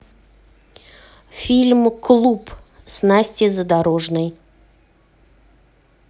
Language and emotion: Russian, neutral